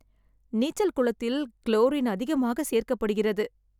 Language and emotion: Tamil, sad